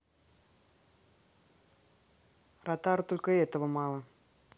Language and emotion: Russian, angry